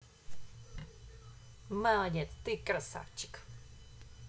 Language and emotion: Russian, positive